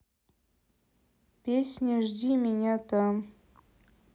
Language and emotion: Russian, sad